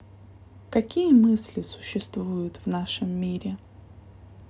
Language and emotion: Russian, sad